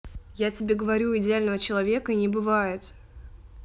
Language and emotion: Russian, angry